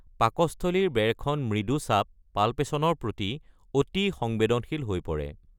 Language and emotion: Assamese, neutral